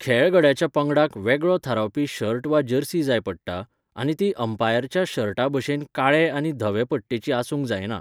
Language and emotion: Goan Konkani, neutral